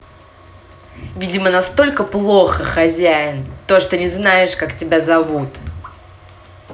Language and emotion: Russian, angry